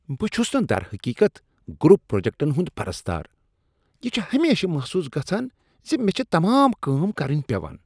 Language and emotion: Kashmiri, disgusted